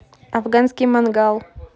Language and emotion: Russian, neutral